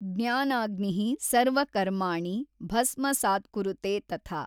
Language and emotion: Kannada, neutral